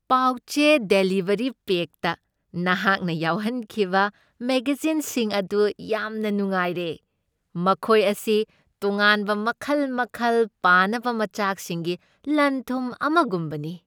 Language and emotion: Manipuri, happy